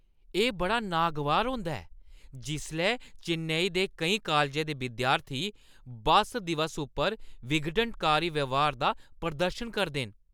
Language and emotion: Dogri, angry